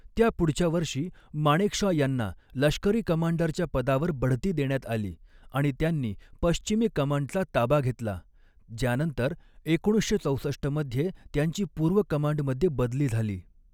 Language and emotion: Marathi, neutral